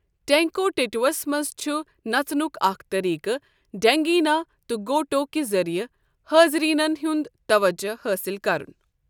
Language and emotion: Kashmiri, neutral